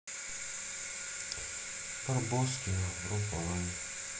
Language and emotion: Russian, sad